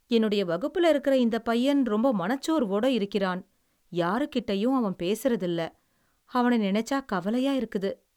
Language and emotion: Tamil, sad